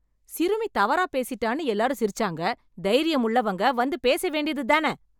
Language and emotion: Tamil, angry